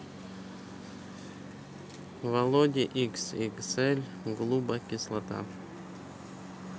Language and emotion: Russian, neutral